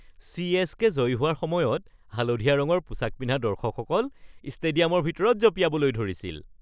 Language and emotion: Assamese, happy